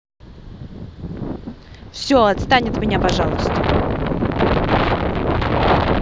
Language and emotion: Russian, angry